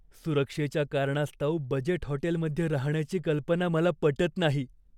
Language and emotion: Marathi, fearful